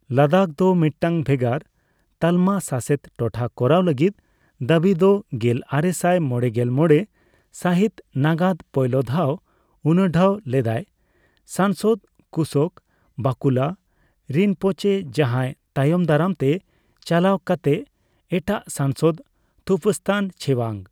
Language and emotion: Santali, neutral